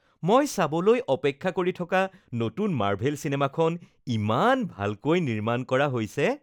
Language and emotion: Assamese, happy